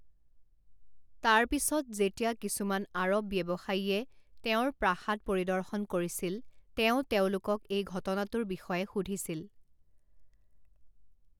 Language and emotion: Assamese, neutral